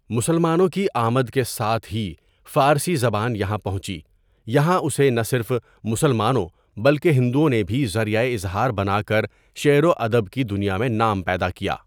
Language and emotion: Urdu, neutral